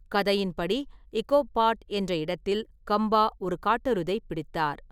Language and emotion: Tamil, neutral